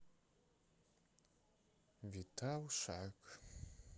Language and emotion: Russian, sad